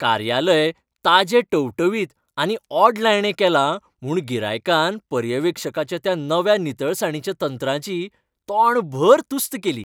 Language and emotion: Goan Konkani, happy